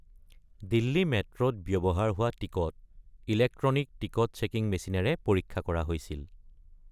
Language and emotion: Assamese, neutral